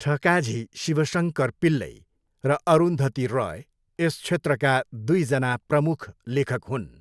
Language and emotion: Nepali, neutral